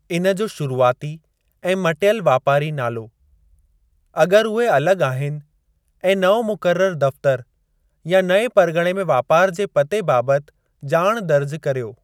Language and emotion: Sindhi, neutral